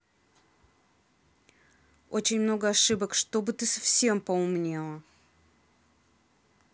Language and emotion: Russian, angry